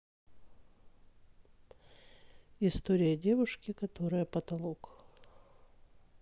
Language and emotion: Russian, neutral